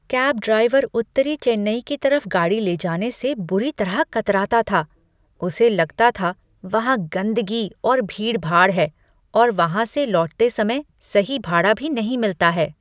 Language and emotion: Hindi, disgusted